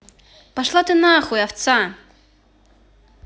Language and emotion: Russian, angry